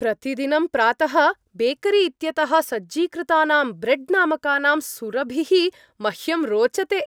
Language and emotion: Sanskrit, happy